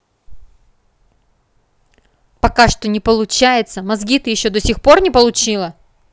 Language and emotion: Russian, angry